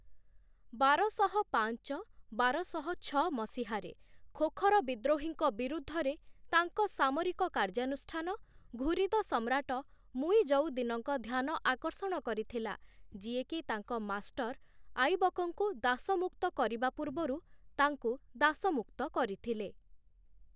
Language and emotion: Odia, neutral